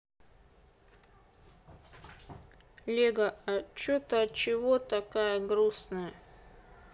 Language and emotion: Russian, neutral